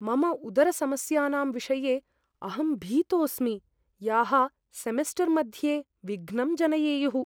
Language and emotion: Sanskrit, fearful